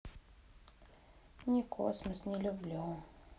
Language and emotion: Russian, sad